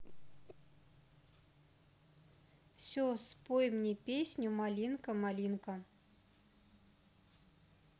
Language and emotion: Russian, neutral